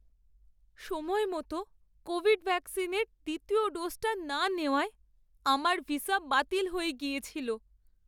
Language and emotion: Bengali, sad